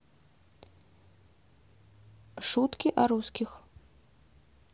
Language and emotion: Russian, neutral